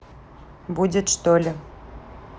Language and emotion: Russian, neutral